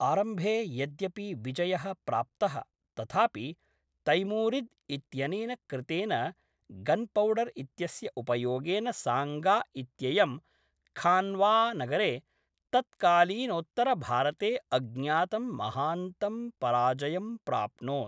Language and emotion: Sanskrit, neutral